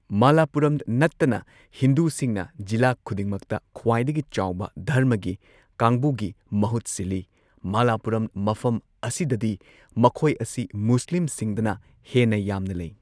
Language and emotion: Manipuri, neutral